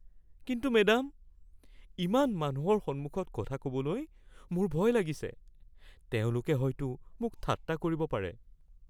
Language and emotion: Assamese, fearful